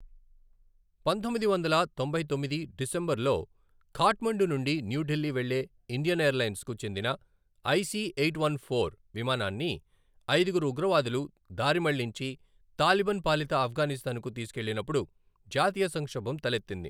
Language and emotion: Telugu, neutral